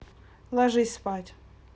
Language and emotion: Russian, neutral